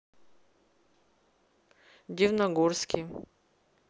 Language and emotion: Russian, neutral